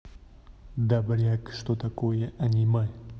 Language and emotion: Russian, angry